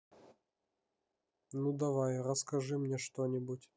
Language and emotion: Russian, neutral